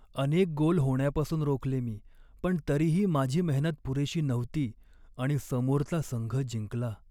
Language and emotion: Marathi, sad